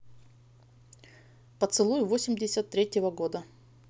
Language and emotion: Russian, neutral